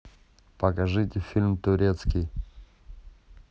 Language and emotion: Russian, neutral